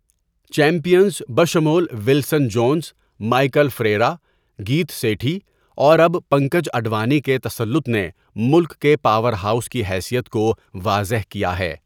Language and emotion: Urdu, neutral